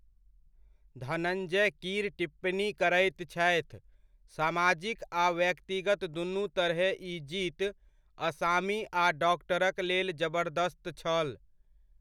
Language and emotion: Maithili, neutral